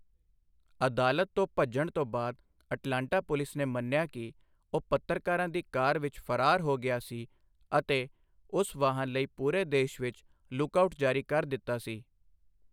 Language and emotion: Punjabi, neutral